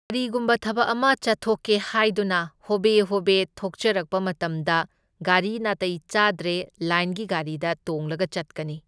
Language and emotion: Manipuri, neutral